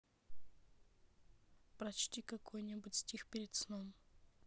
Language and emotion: Russian, neutral